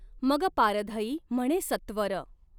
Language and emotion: Marathi, neutral